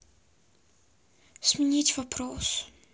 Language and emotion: Russian, sad